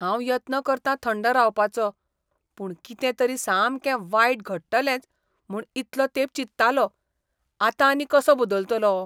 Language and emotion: Goan Konkani, disgusted